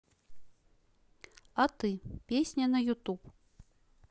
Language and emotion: Russian, neutral